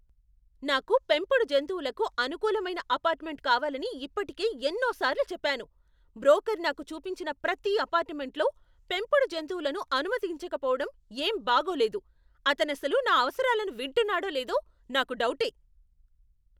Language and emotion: Telugu, angry